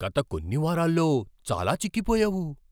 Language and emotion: Telugu, surprised